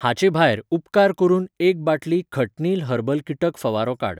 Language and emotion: Goan Konkani, neutral